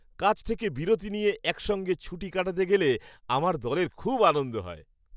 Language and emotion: Bengali, happy